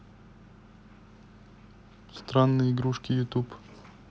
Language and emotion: Russian, neutral